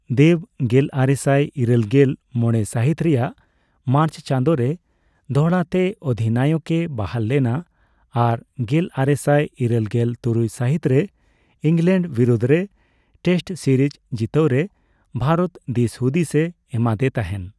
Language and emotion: Santali, neutral